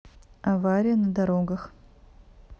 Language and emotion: Russian, neutral